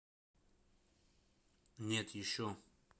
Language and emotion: Russian, neutral